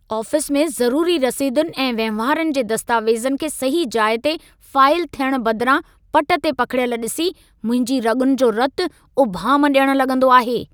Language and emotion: Sindhi, angry